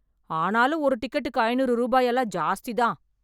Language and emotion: Tamil, angry